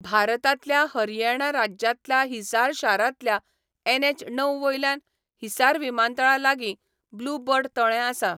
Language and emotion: Goan Konkani, neutral